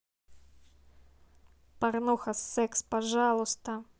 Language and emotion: Russian, neutral